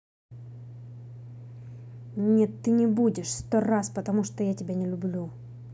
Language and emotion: Russian, angry